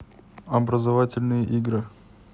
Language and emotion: Russian, neutral